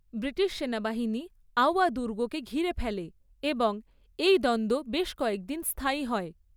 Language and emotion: Bengali, neutral